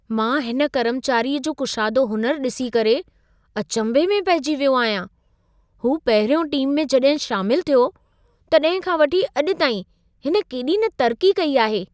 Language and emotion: Sindhi, surprised